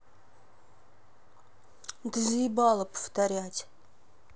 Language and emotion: Russian, angry